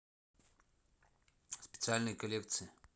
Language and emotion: Russian, neutral